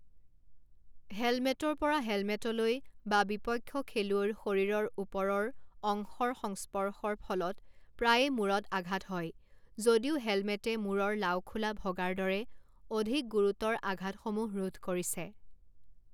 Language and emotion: Assamese, neutral